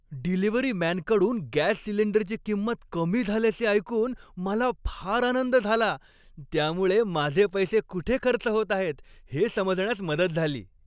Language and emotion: Marathi, happy